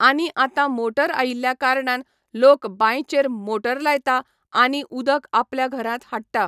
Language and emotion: Goan Konkani, neutral